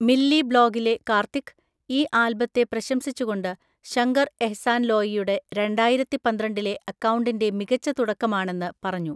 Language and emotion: Malayalam, neutral